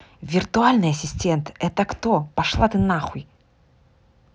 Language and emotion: Russian, angry